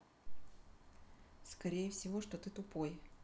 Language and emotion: Russian, neutral